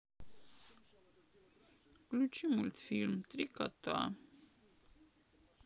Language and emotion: Russian, sad